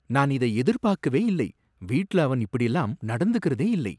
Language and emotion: Tamil, surprised